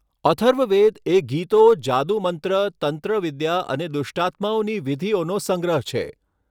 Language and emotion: Gujarati, neutral